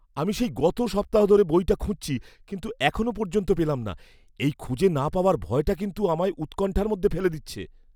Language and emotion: Bengali, fearful